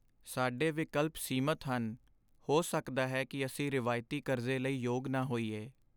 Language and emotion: Punjabi, sad